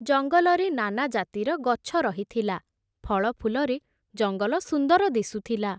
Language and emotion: Odia, neutral